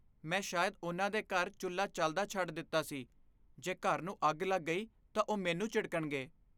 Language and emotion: Punjabi, fearful